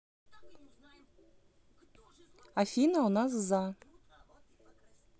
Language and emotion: Russian, neutral